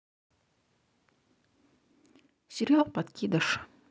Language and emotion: Russian, neutral